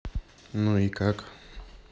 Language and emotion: Russian, neutral